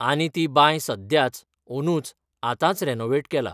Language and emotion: Goan Konkani, neutral